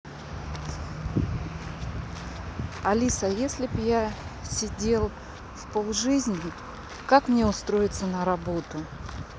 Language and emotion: Russian, neutral